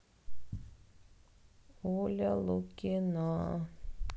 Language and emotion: Russian, sad